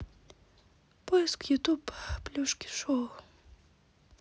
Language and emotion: Russian, sad